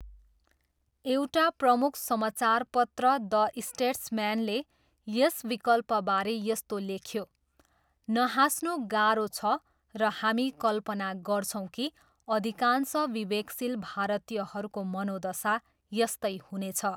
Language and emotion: Nepali, neutral